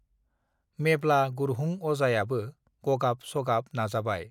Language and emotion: Bodo, neutral